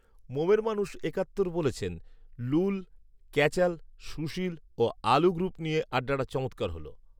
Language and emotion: Bengali, neutral